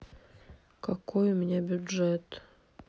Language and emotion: Russian, sad